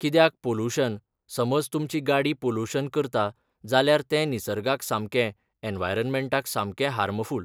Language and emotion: Goan Konkani, neutral